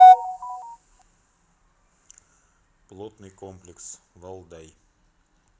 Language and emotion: Russian, neutral